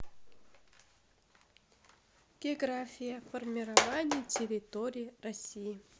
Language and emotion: Russian, neutral